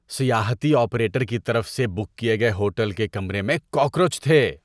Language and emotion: Urdu, disgusted